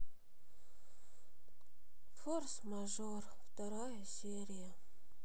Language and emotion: Russian, sad